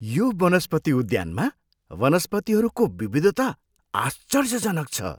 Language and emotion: Nepali, surprised